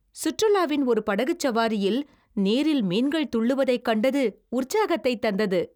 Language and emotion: Tamil, happy